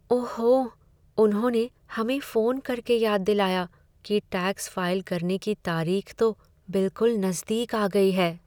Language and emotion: Hindi, sad